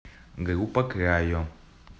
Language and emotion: Russian, neutral